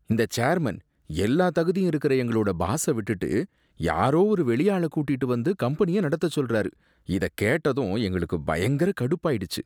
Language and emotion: Tamil, disgusted